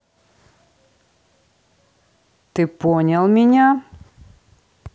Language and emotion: Russian, neutral